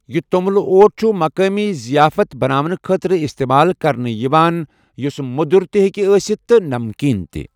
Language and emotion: Kashmiri, neutral